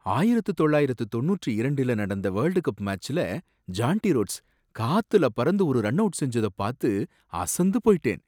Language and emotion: Tamil, surprised